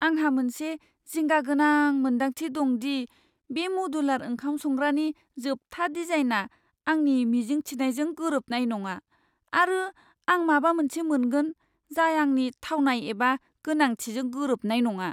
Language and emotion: Bodo, fearful